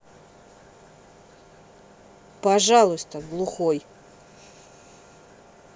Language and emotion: Russian, neutral